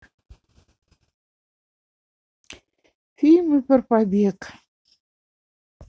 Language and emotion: Russian, sad